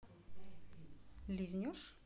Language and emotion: Russian, neutral